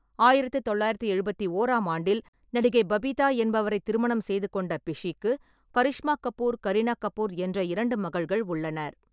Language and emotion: Tamil, neutral